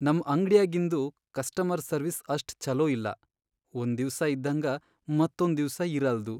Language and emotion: Kannada, sad